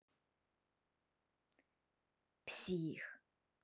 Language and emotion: Russian, angry